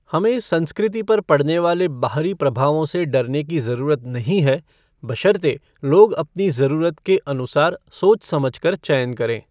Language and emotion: Hindi, neutral